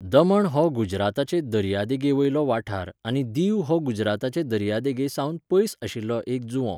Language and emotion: Goan Konkani, neutral